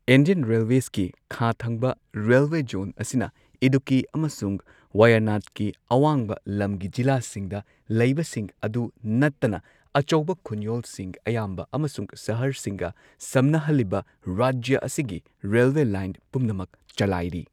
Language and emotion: Manipuri, neutral